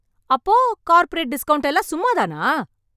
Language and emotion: Tamil, angry